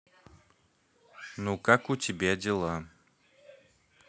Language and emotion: Russian, neutral